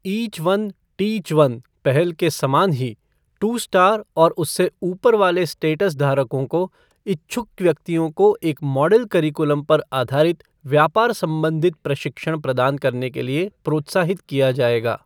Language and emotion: Hindi, neutral